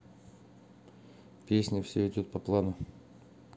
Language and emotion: Russian, neutral